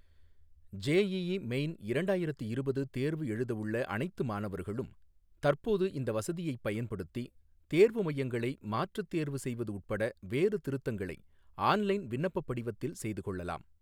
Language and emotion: Tamil, neutral